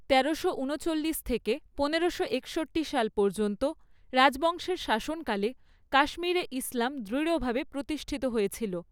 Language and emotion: Bengali, neutral